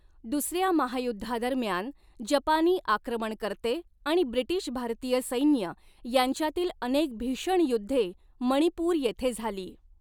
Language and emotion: Marathi, neutral